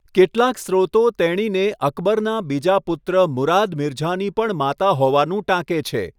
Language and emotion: Gujarati, neutral